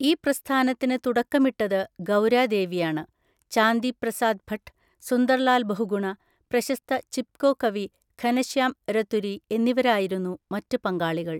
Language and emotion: Malayalam, neutral